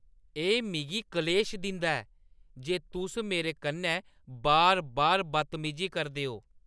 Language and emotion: Dogri, angry